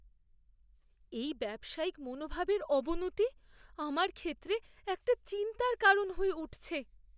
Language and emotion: Bengali, fearful